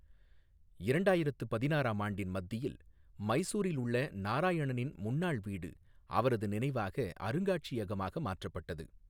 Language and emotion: Tamil, neutral